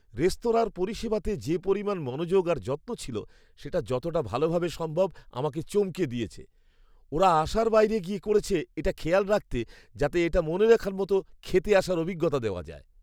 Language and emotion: Bengali, surprised